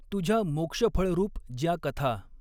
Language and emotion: Marathi, neutral